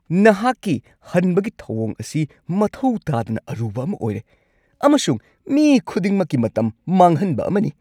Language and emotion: Manipuri, angry